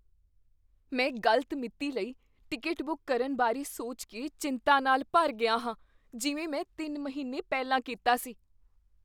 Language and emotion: Punjabi, fearful